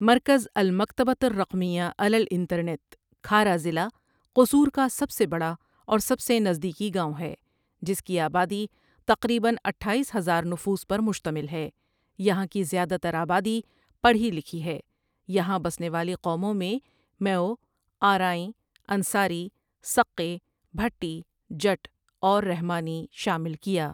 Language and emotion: Urdu, neutral